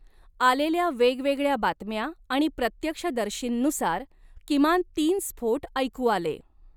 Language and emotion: Marathi, neutral